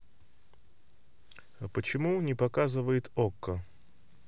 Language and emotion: Russian, neutral